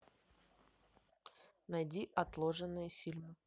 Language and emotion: Russian, neutral